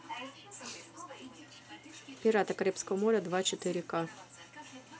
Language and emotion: Russian, neutral